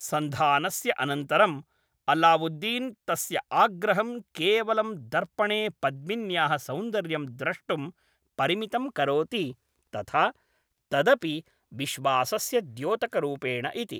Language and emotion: Sanskrit, neutral